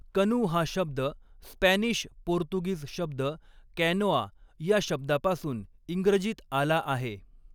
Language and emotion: Marathi, neutral